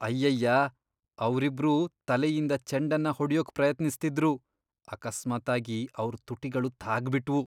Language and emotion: Kannada, disgusted